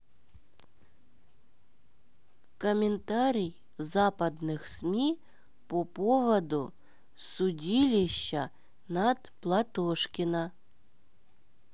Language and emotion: Russian, neutral